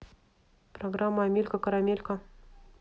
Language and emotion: Russian, neutral